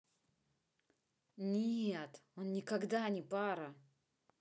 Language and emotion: Russian, neutral